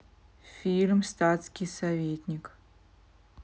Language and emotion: Russian, neutral